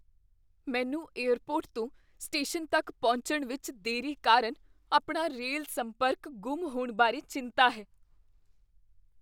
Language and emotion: Punjabi, fearful